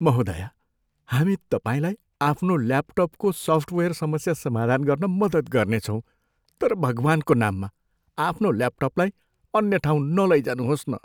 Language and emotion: Nepali, fearful